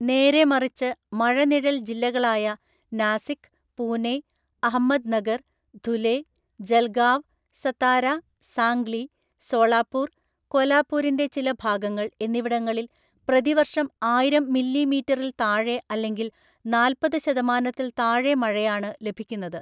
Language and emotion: Malayalam, neutral